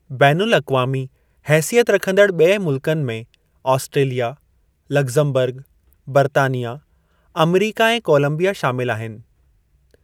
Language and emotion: Sindhi, neutral